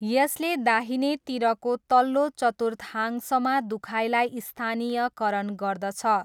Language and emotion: Nepali, neutral